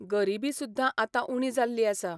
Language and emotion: Goan Konkani, neutral